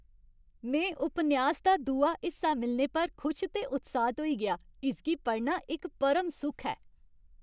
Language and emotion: Dogri, happy